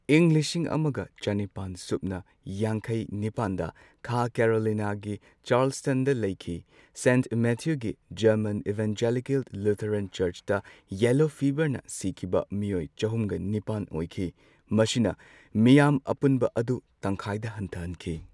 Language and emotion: Manipuri, neutral